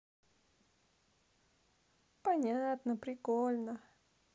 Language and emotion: Russian, positive